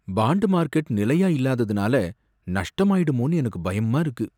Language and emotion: Tamil, fearful